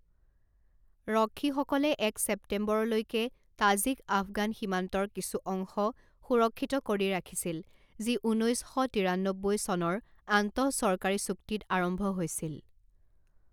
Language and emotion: Assamese, neutral